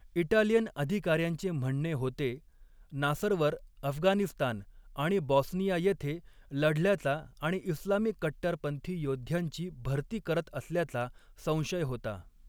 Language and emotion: Marathi, neutral